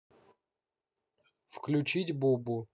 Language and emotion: Russian, neutral